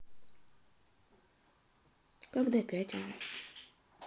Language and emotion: Russian, neutral